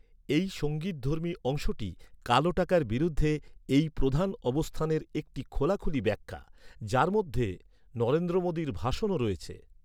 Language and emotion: Bengali, neutral